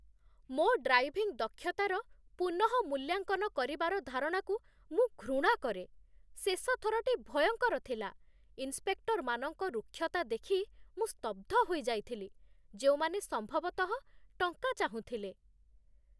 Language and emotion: Odia, disgusted